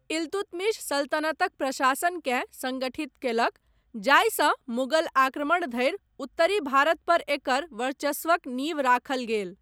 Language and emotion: Maithili, neutral